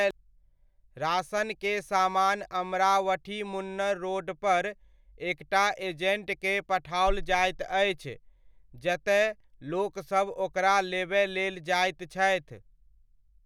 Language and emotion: Maithili, neutral